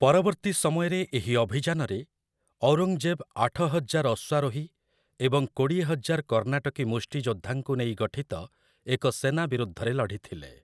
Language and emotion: Odia, neutral